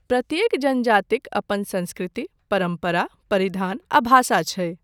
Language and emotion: Maithili, neutral